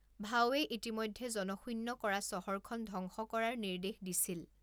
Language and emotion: Assamese, neutral